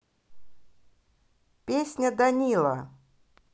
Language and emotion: Russian, neutral